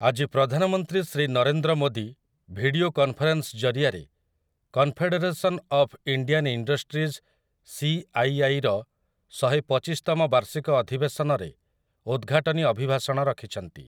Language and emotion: Odia, neutral